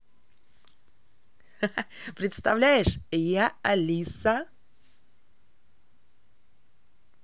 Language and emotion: Russian, positive